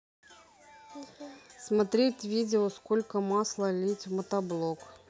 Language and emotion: Russian, neutral